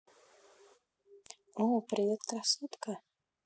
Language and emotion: Russian, neutral